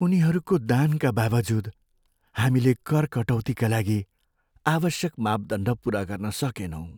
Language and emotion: Nepali, sad